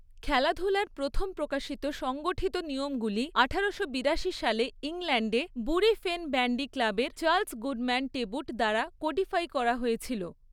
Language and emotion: Bengali, neutral